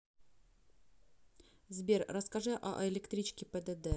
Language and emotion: Russian, neutral